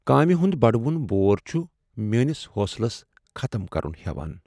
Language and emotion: Kashmiri, sad